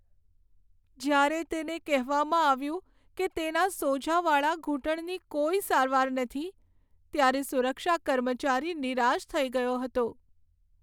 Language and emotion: Gujarati, sad